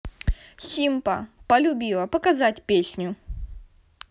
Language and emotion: Russian, neutral